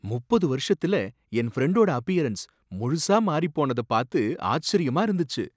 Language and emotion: Tamil, surprised